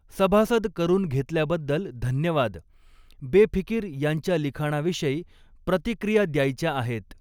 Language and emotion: Marathi, neutral